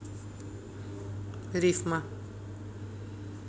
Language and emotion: Russian, neutral